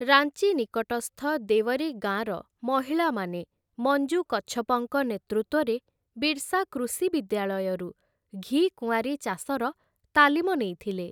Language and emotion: Odia, neutral